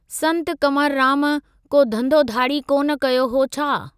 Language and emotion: Sindhi, neutral